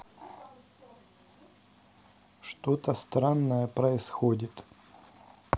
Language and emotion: Russian, neutral